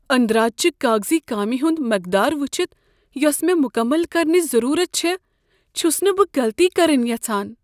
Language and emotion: Kashmiri, fearful